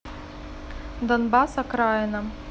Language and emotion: Russian, neutral